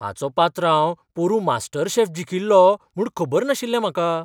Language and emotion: Goan Konkani, surprised